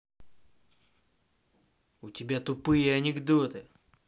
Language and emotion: Russian, angry